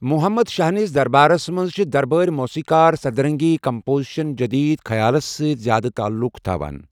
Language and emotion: Kashmiri, neutral